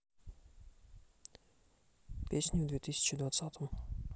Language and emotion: Russian, neutral